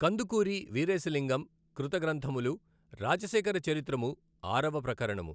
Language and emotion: Telugu, neutral